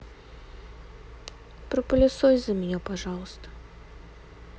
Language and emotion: Russian, sad